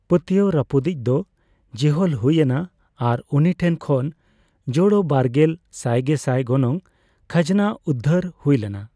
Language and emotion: Santali, neutral